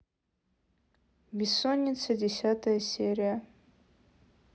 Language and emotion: Russian, neutral